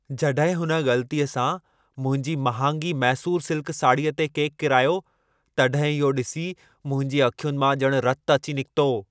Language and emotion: Sindhi, angry